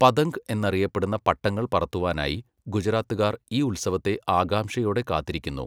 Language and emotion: Malayalam, neutral